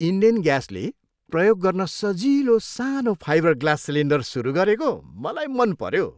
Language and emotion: Nepali, happy